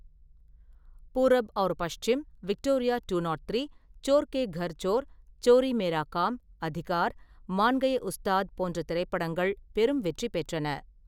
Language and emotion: Tamil, neutral